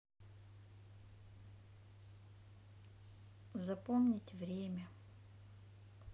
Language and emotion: Russian, sad